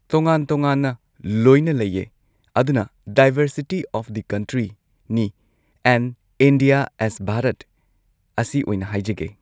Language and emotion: Manipuri, neutral